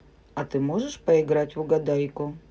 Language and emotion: Russian, positive